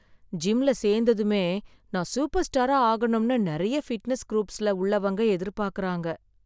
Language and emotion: Tamil, sad